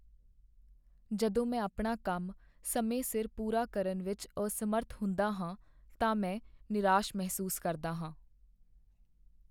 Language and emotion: Punjabi, sad